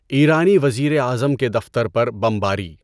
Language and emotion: Urdu, neutral